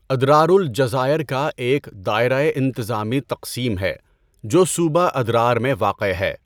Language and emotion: Urdu, neutral